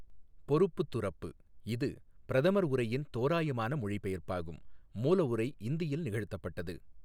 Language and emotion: Tamil, neutral